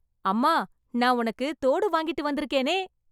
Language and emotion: Tamil, happy